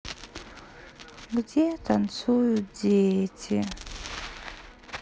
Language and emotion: Russian, sad